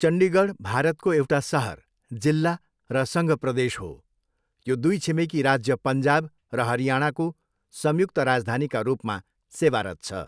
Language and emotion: Nepali, neutral